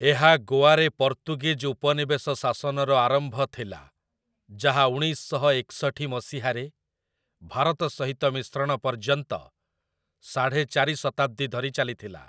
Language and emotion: Odia, neutral